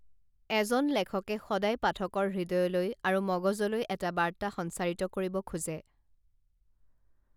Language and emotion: Assamese, neutral